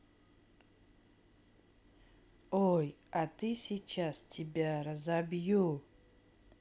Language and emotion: Russian, neutral